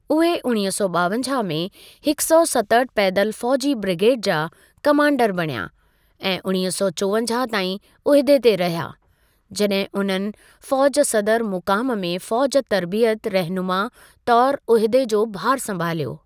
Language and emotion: Sindhi, neutral